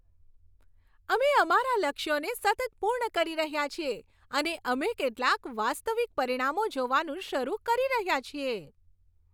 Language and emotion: Gujarati, happy